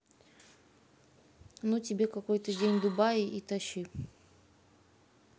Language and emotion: Russian, neutral